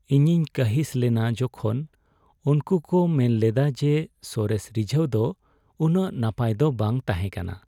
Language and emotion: Santali, sad